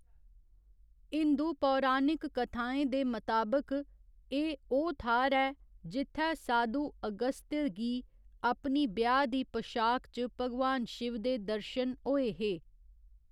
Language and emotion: Dogri, neutral